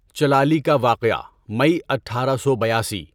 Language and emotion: Urdu, neutral